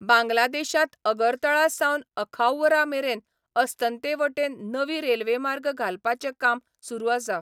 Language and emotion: Goan Konkani, neutral